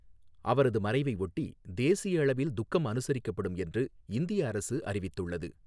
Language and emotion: Tamil, neutral